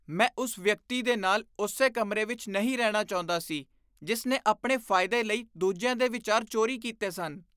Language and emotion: Punjabi, disgusted